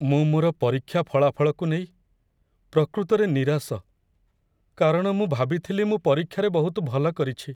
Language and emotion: Odia, sad